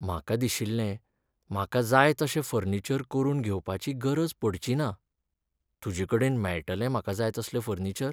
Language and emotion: Goan Konkani, sad